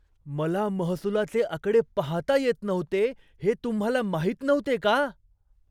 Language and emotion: Marathi, surprised